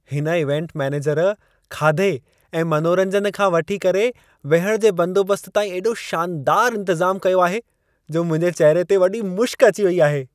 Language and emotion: Sindhi, happy